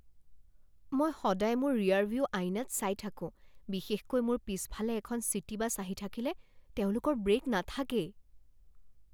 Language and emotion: Assamese, fearful